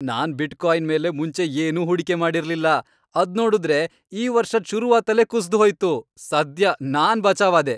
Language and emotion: Kannada, happy